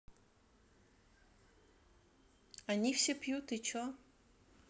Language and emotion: Russian, neutral